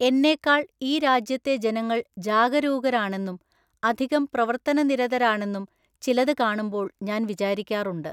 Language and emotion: Malayalam, neutral